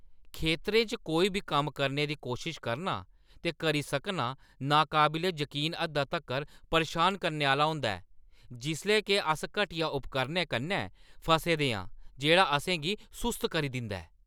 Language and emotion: Dogri, angry